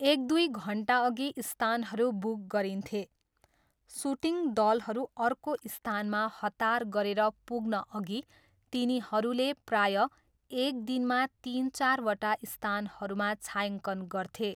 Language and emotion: Nepali, neutral